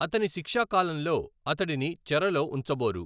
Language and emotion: Telugu, neutral